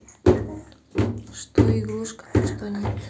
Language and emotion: Russian, neutral